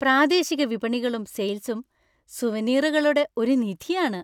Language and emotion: Malayalam, happy